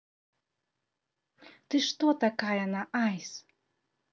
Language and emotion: Russian, positive